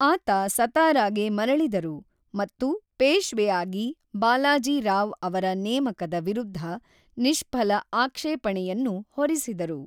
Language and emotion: Kannada, neutral